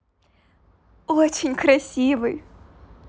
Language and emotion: Russian, positive